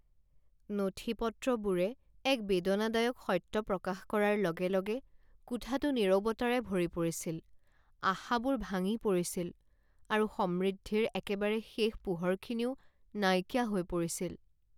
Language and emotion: Assamese, sad